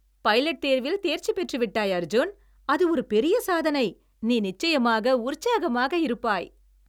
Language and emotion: Tamil, happy